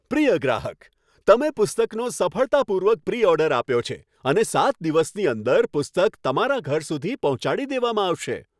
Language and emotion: Gujarati, happy